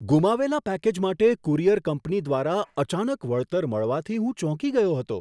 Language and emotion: Gujarati, surprised